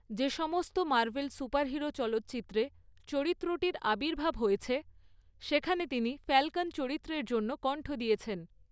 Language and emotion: Bengali, neutral